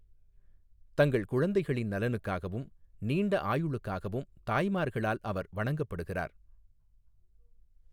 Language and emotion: Tamil, neutral